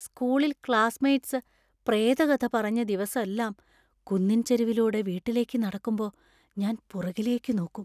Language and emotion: Malayalam, fearful